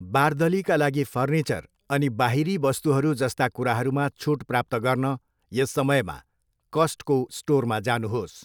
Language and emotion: Nepali, neutral